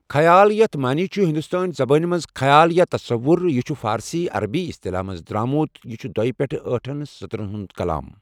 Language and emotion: Kashmiri, neutral